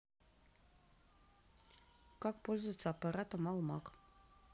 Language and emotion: Russian, neutral